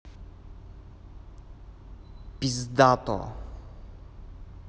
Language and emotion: Russian, neutral